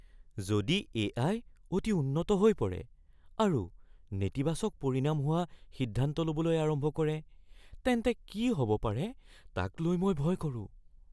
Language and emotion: Assamese, fearful